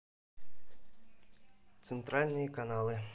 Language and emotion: Russian, neutral